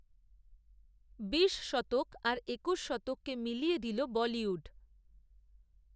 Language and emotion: Bengali, neutral